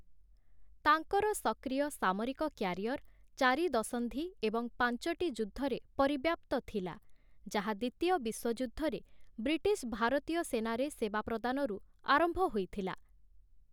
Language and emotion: Odia, neutral